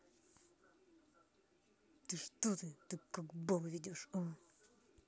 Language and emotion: Russian, angry